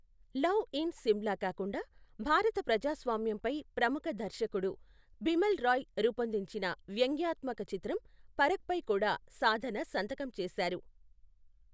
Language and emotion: Telugu, neutral